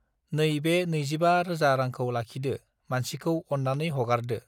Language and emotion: Bodo, neutral